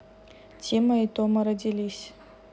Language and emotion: Russian, neutral